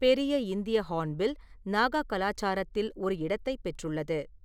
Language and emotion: Tamil, neutral